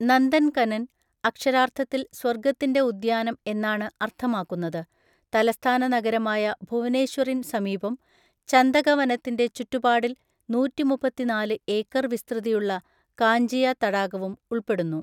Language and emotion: Malayalam, neutral